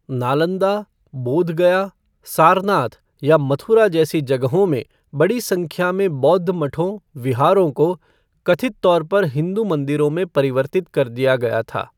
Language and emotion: Hindi, neutral